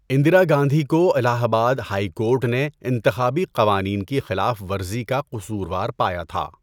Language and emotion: Urdu, neutral